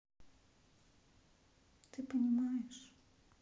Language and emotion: Russian, sad